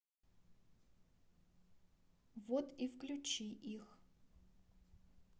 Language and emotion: Russian, neutral